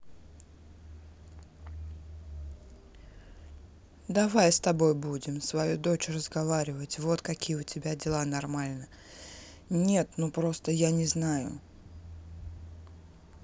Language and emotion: Russian, neutral